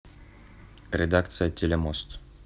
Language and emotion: Russian, neutral